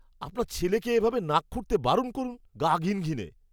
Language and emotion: Bengali, disgusted